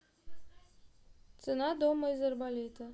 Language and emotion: Russian, neutral